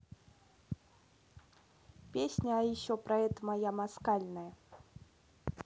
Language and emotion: Russian, neutral